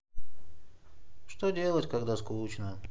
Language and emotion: Russian, sad